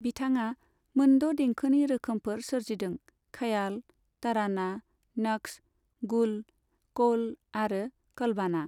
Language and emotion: Bodo, neutral